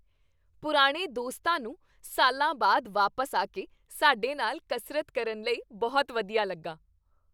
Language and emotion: Punjabi, happy